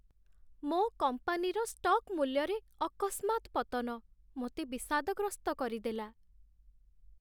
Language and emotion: Odia, sad